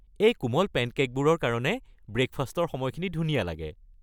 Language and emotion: Assamese, happy